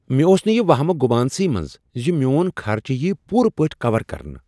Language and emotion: Kashmiri, surprised